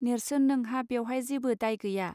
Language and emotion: Bodo, neutral